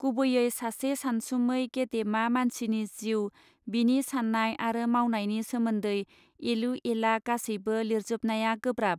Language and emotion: Bodo, neutral